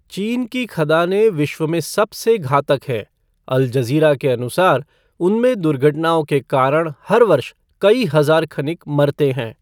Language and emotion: Hindi, neutral